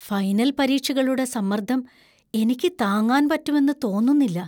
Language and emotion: Malayalam, fearful